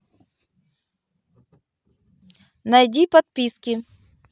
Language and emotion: Russian, neutral